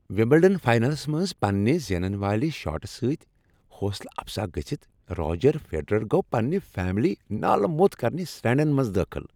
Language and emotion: Kashmiri, happy